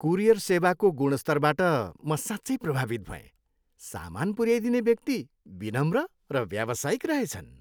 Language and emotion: Nepali, happy